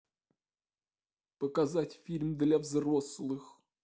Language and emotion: Russian, sad